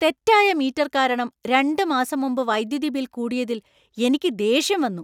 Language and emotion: Malayalam, angry